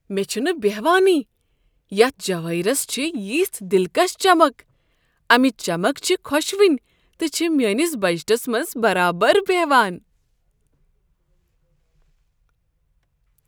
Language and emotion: Kashmiri, surprised